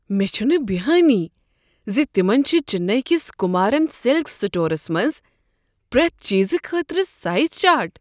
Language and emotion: Kashmiri, surprised